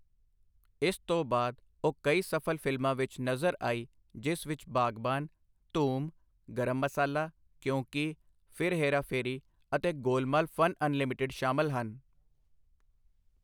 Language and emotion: Punjabi, neutral